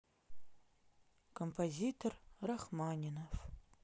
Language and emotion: Russian, sad